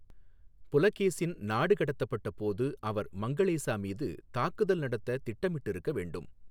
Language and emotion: Tamil, neutral